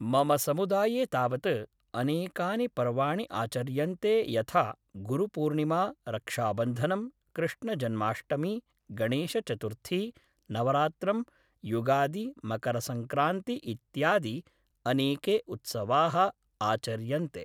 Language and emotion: Sanskrit, neutral